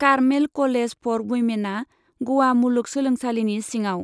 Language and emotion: Bodo, neutral